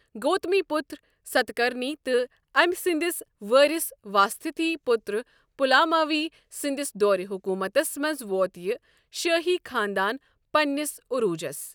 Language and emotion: Kashmiri, neutral